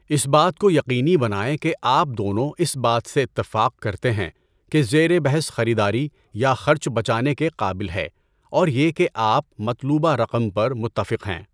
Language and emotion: Urdu, neutral